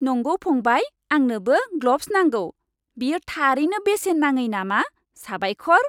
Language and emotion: Bodo, happy